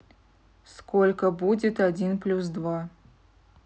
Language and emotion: Russian, neutral